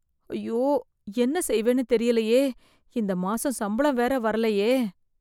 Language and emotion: Tamil, fearful